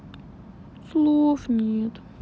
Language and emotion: Russian, sad